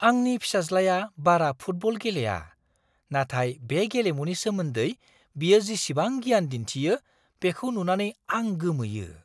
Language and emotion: Bodo, surprised